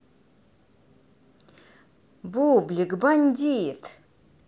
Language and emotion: Russian, positive